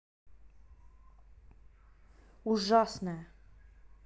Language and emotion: Russian, neutral